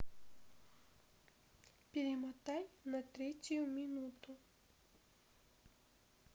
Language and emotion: Russian, neutral